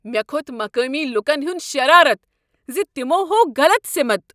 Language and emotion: Kashmiri, angry